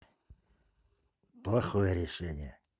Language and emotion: Russian, neutral